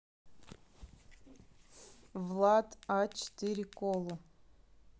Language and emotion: Russian, neutral